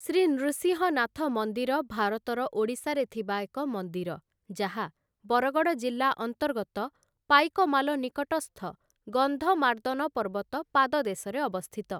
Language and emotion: Odia, neutral